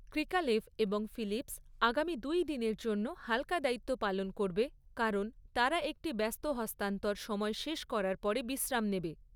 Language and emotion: Bengali, neutral